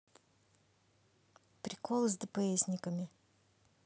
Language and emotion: Russian, neutral